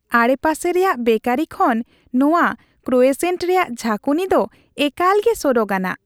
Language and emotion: Santali, happy